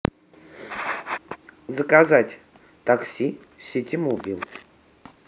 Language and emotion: Russian, neutral